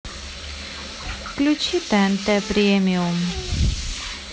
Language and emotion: Russian, neutral